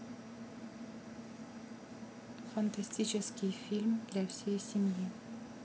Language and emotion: Russian, neutral